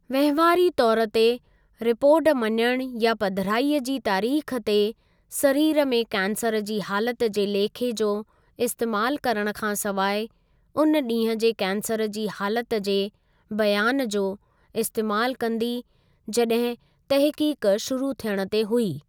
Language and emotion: Sindhi, neutral